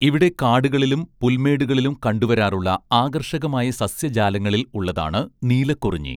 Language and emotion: Malayalam, neutral